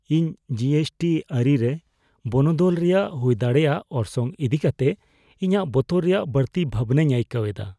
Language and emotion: Santali, fearful